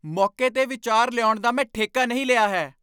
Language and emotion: Punjabi, angry